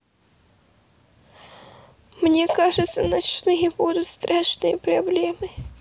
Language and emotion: Russian, sad